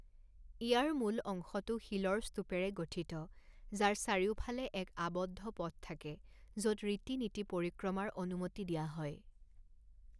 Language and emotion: Assamese, neutral